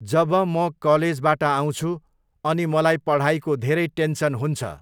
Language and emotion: Nepali, neutral